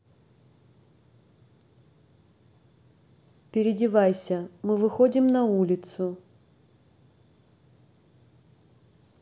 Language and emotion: Russian, neutral